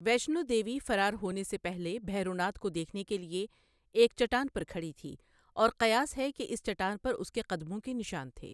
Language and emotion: Urdu, neutral